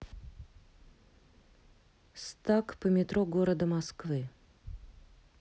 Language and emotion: Russian, neutral